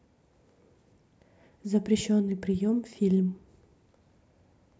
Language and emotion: Russian, neutral